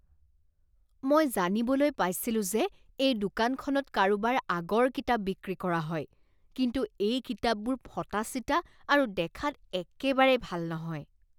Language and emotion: Assamese, disgusted